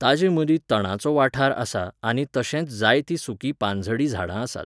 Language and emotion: Goan Konkani, neutral